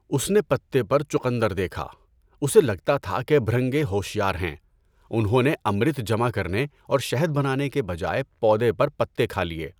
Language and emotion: Urdu, neutral